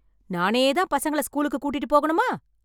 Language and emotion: Tamil, angry